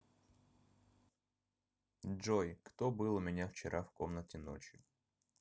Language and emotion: Russian, neutral